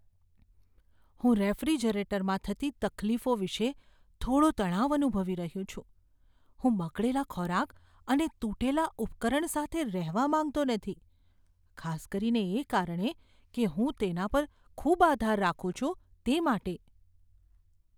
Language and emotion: Gujarati, fearful